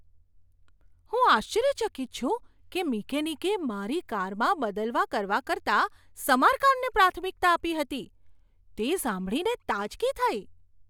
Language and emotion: Gujarati, surprised